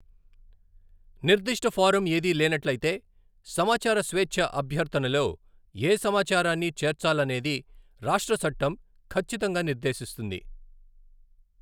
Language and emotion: Telugu, neutral